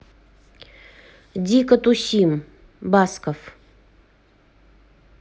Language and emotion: Russian, neutral